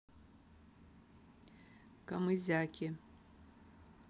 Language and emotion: Russian, neutral